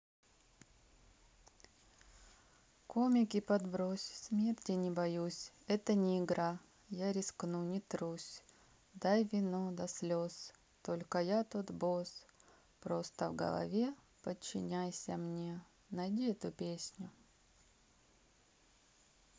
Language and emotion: Russian, neutral